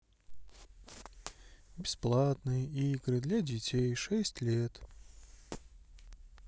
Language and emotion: Russian, sad